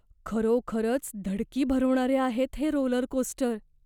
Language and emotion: Marathi, fearful